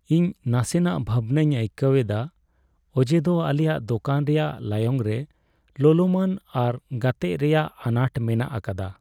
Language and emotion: Santali, sad